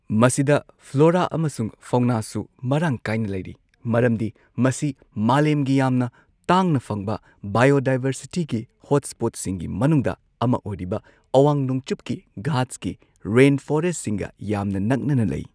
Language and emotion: Manipuri, neutral